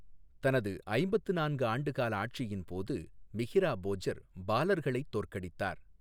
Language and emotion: Tamil, neutral